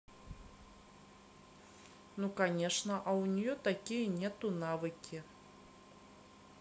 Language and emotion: Russian, neutral